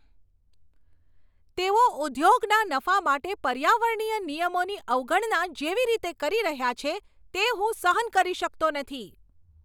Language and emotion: Gujarati, angry